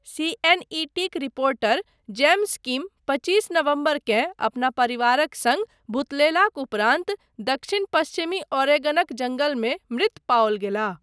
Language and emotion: Maithili, neutral